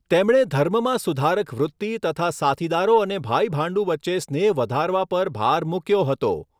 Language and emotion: Gujarati, neutral